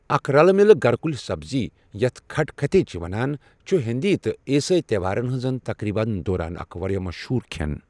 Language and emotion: Kashmiri, neutral